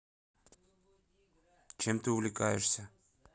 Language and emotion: Russian, neutral